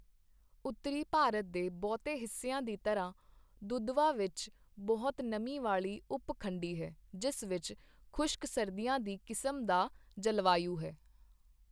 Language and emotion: Punjabi, neutral